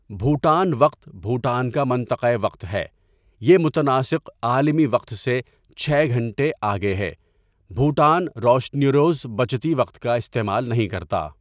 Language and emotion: Urdu, neutral